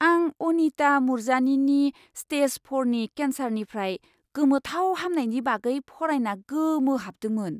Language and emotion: Bodo, surprised